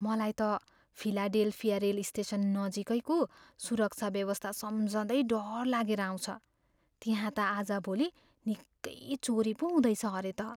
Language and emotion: Nepali, fearful